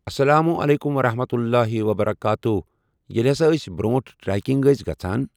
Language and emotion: Kashmiri, neutral